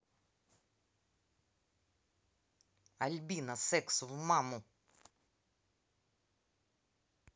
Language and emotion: Russian, angry